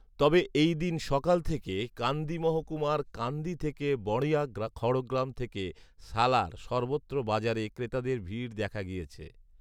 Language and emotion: Bengali, neutral